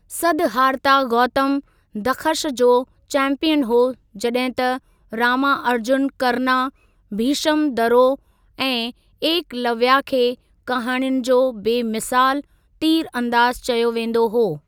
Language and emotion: Sindhi, neutral